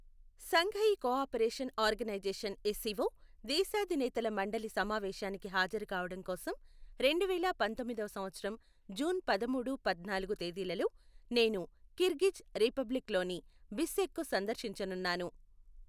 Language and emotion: Telugu, neutral